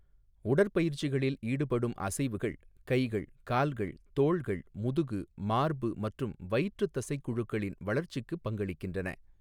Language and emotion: Tamil, neutral